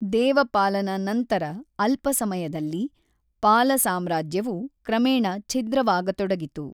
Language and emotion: Kannada, neutral